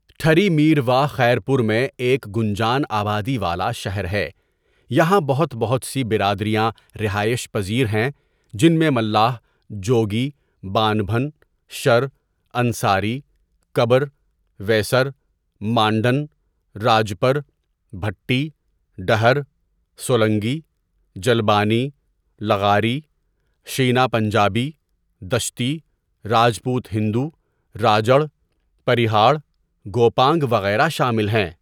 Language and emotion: Urdu, neutral